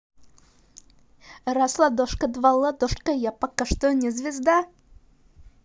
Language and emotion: Russian, positive